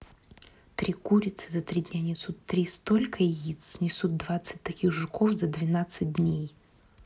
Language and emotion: Russian, neutral